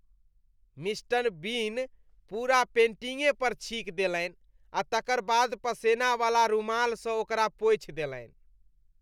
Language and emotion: Maithili, disgusted